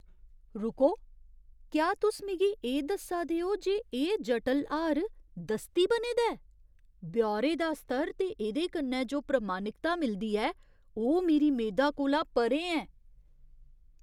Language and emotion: Dogri, surprised